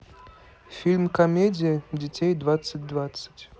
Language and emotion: Russian, neutral